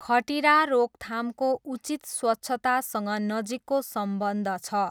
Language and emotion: Nepali, neutral